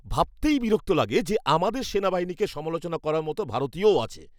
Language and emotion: Bengali, angry